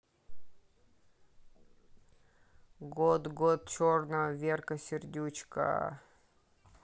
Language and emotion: Russian, neutral